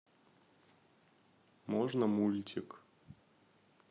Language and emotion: Russian, neutral